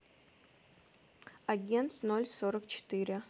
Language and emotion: Russian, neutral